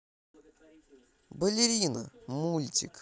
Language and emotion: Russian, positive